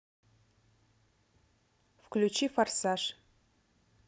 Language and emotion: Russian, neutral